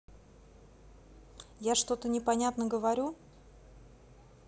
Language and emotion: Russian, neutral